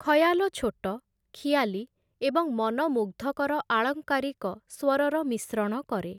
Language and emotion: Odia, neutral